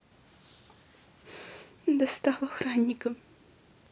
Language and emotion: Russian, sad